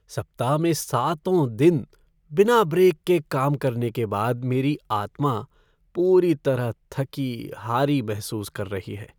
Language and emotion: Hindi, sad